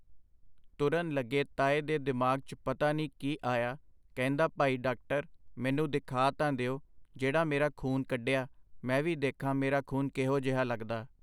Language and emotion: Punjabi, neutral